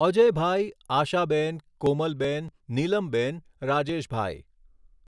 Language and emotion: Gujarati, neutral